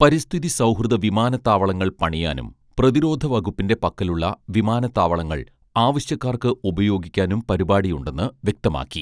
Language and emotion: Malayalam, neutral